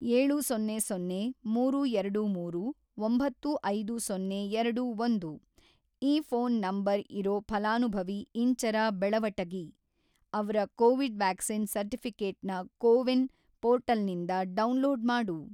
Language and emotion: Kannada, neutral